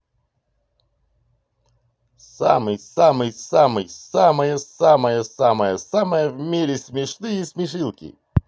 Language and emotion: Russian, positive